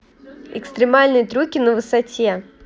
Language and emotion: Russian, neutral